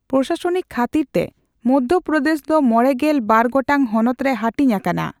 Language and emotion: Santali, neutral